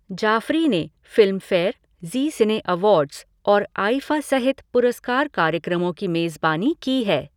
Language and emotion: Hindi, neutral